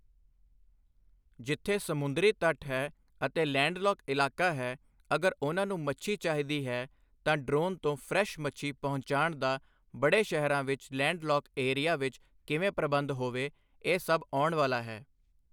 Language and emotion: Punjabi, neutral